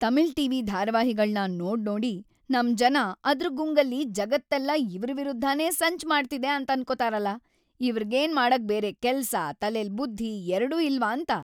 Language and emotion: Kannada, angry